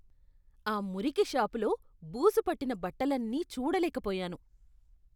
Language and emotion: Telugu, disgusted